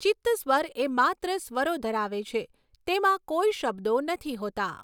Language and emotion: Gujarati, neutral